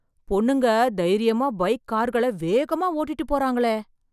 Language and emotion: Tamil, surprised